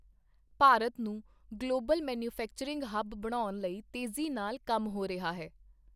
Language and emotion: Punjabi, neutral